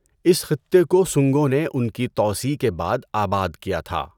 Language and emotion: Urdu, neutral